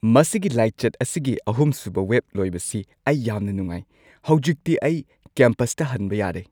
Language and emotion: Manipuri, happy